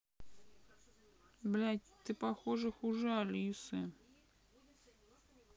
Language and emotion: Russian, sad